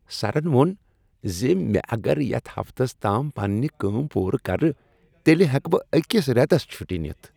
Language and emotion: Kashmiri, happy